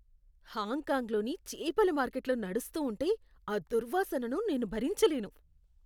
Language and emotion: Telugu, disgusted